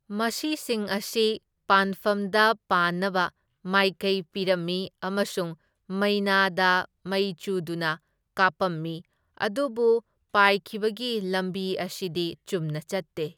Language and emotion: Manipuri, neutral